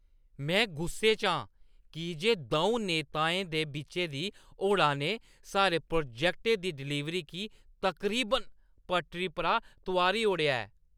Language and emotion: Dogri, angry